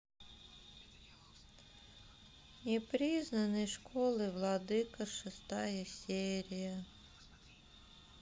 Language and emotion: Russian, sad